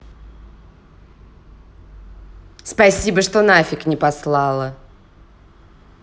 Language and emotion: Russian, angry